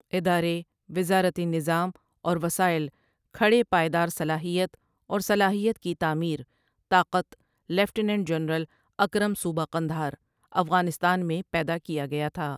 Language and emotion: Urdu, neutral